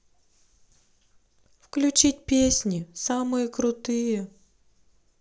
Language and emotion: Russian, sad